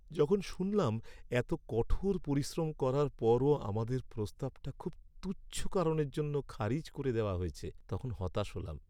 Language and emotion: Bengali, sad